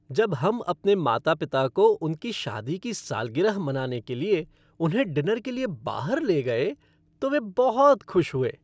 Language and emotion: Hindi, happy